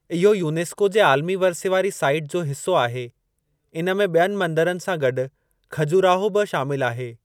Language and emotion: Sindhi, neutral